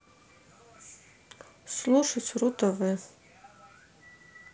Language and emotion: Russian, neutral